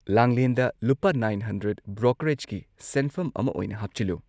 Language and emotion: Manipuri, neutral